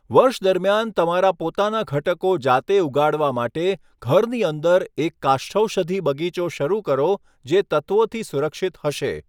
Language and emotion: Gujarati, neutral